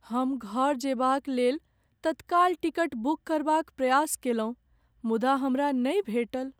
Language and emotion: Maithili, sad